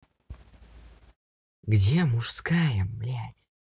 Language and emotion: Russian, angry